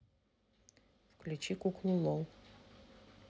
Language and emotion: Russian, neutral